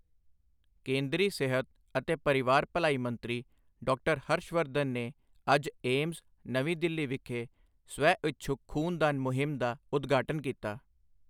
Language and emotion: Punjabi, neutral